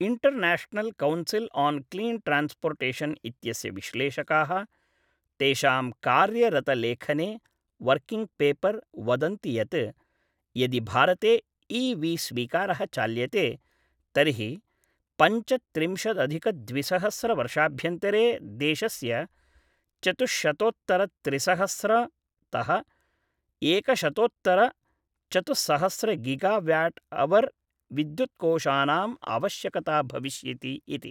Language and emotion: Sanskrit, neutral